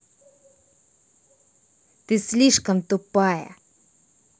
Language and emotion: Russian, angry